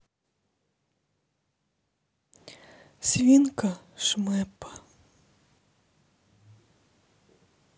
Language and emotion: Russian, sad